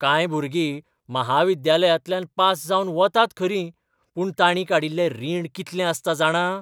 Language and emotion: Goan Konkani, surprised